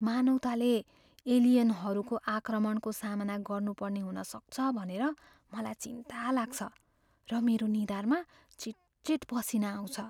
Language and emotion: Nepali, fearful